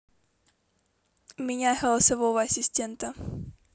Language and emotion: Russian, neutral